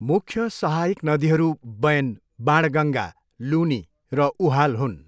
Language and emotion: Nepali, neutral